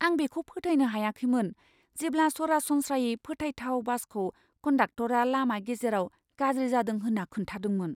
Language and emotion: Bodo, surprised